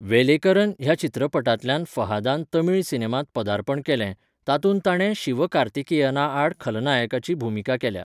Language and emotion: Goan Konkani, neutral